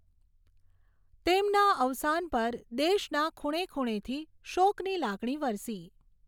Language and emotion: Gujarati, neutral